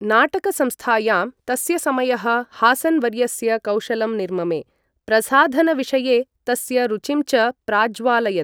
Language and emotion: Sanskrit, neutral